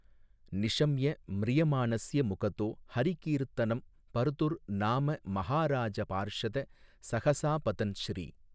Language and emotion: Tamil, neutral